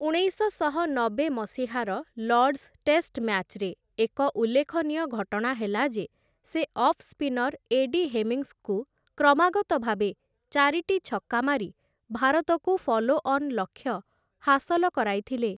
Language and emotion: Odia, neutral